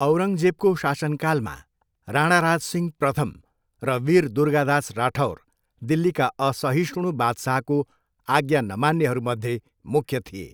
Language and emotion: Nepali, neutral